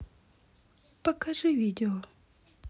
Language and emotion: Russian, sad